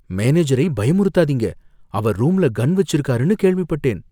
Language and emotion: Tamil, fearful